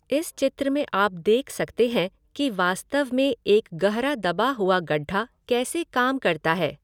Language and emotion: Hindi, neutral